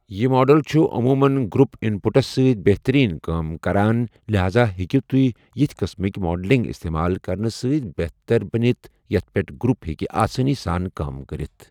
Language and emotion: Kashmiri, neutral